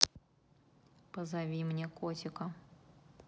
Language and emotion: Russian, neutral